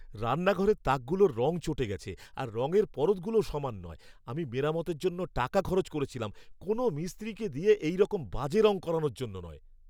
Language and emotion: Bengali, angry